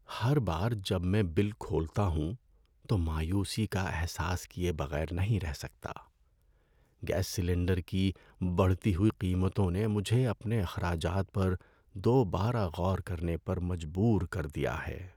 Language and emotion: Urdu, sad